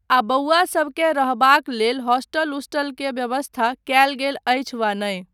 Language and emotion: Maithili, neutral